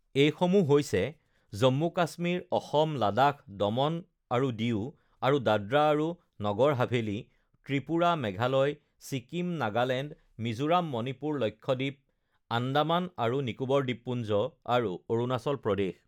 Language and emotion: Assamese, neutral